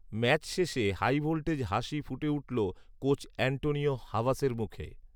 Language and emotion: Bengali, neutral